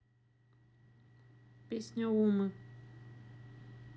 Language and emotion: Russian, neutral